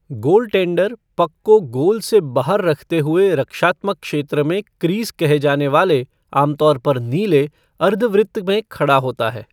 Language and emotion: Hindi, neutral